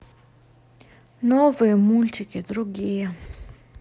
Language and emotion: Russian, neutral